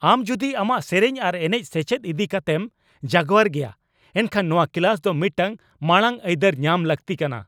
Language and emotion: Santali, angry